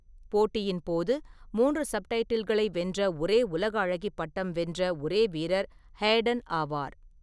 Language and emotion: Tamil, neutral